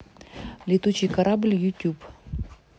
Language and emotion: Russian, neutral